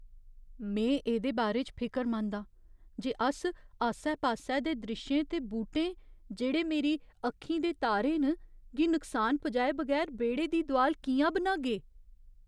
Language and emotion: Dogri, fearful